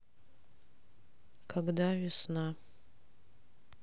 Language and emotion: Russian, sad